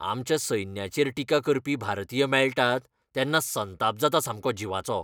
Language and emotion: Goan Konkani, angry